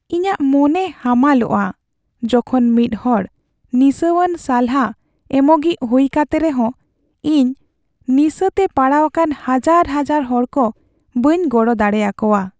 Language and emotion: Santali, sad